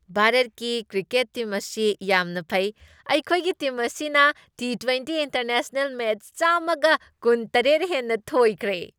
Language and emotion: Manipuri, happy